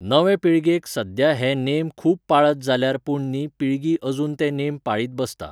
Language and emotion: Goan Konkani, neutral